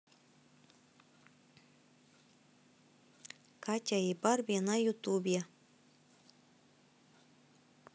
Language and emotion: Russian, neutral